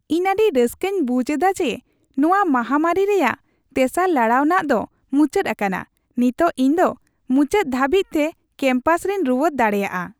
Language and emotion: Santali, happy